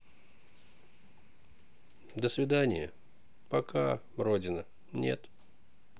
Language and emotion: Russian, sad